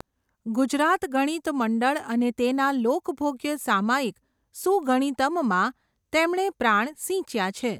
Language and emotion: Gujarati, neutral